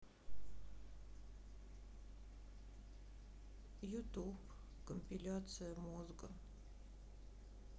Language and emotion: Russian, sad